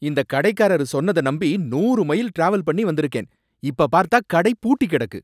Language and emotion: Tamil, angry